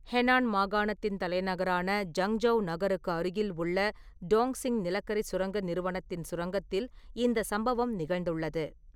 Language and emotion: Tamil, neutral